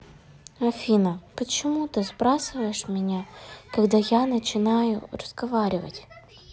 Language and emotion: Russian, sad